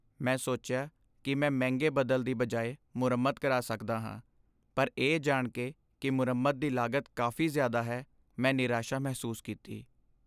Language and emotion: Punjabi, sad